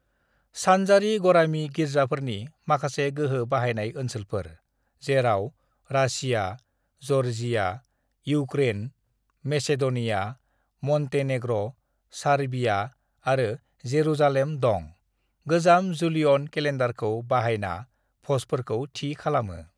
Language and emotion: Bodo, neutral